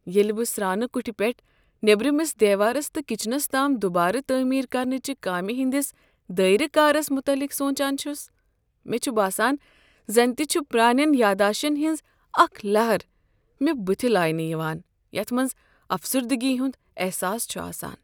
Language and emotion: Kashmiri, sad